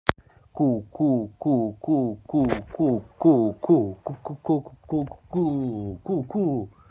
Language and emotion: Russian, positive